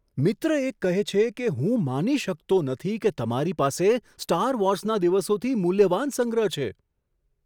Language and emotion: Gujarati, surprised